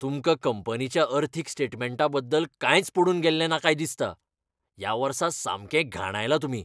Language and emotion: Goan Konkani, angry